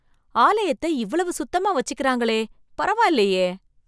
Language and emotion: Tamil, surprised